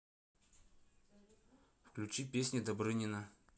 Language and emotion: Russian, neutral